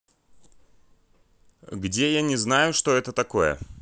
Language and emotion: Russian, neutral